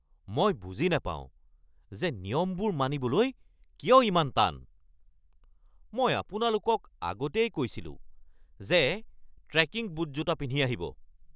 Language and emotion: Assamese, angry